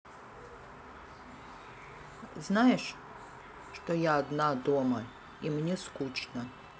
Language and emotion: Russian, sad